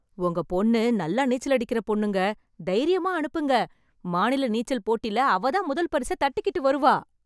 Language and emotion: Tamil, happy